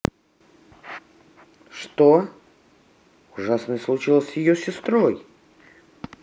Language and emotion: Russian, neutral